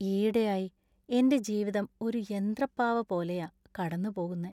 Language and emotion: Malayalam, sad